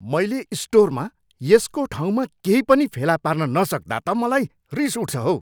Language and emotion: Nepali, angry